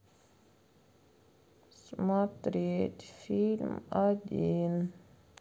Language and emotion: Russian, sad